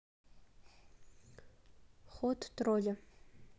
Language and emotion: Russian, neutral